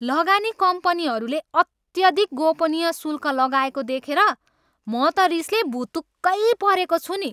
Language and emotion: Nepali, angry